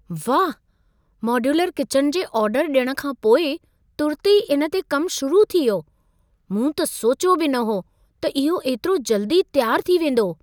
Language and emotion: Sindhi, surprised